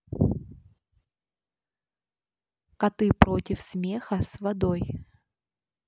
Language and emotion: Russian, neutral